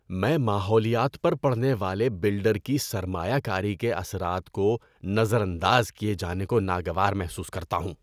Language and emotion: Urdu, disgusted